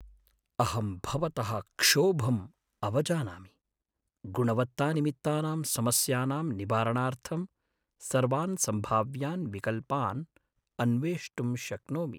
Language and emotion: Sanskrit, sad